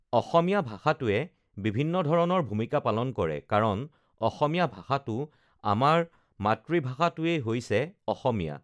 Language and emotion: Assamese, neutral